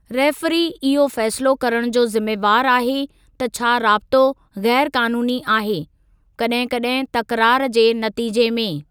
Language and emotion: Sindhi, neutral